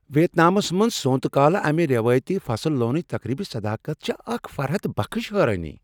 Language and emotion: Kashmiri, surprised